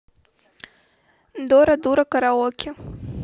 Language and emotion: Russian, neutral